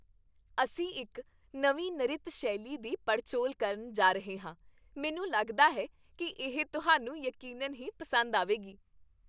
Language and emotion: Punjabi, happy